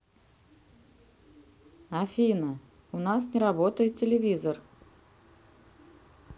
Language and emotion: Russian, neutral